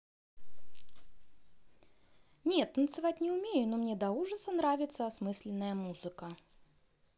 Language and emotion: Russian, positive